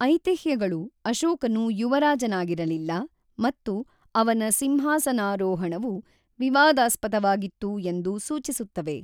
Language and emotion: Kannada, neutral